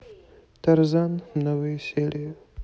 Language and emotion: Russian, sad